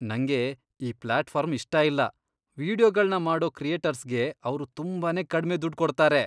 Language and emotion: Kannada, disgusted